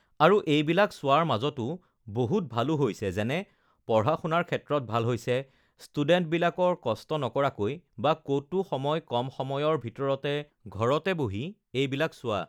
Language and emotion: Assamese, neutral